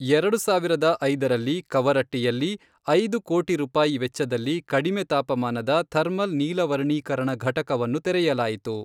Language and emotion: Kannada, neutral